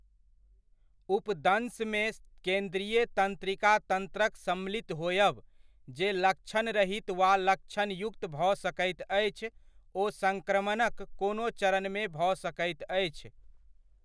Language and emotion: Maithili, neutral